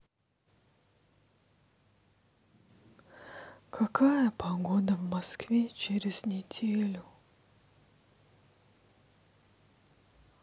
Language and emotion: Russian, sad